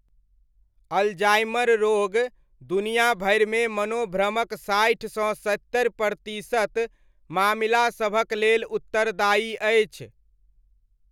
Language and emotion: Maithili, neutral